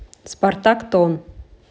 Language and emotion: Russian, neutral